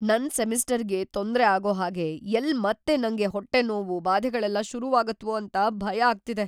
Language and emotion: Kannada, fearful